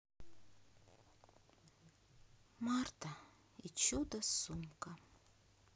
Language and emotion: Russian, sad